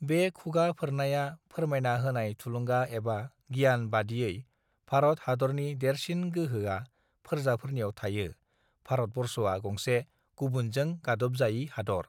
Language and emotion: Bodo, neutral